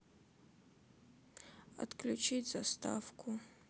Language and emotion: Russian, sad